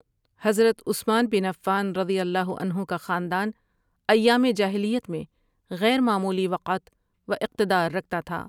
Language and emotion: Urdu, neutral